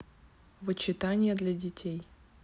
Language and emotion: Russian, neutral